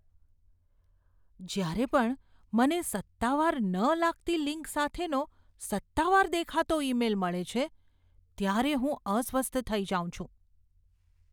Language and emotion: Gujarati, fearful